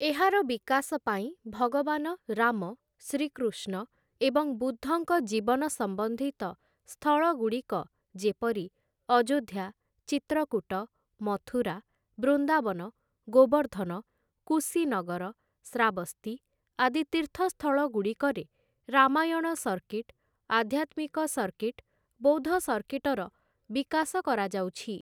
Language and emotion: Odia, neutral